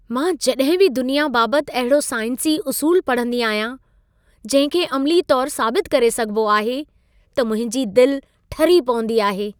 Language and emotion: Sindhi, happy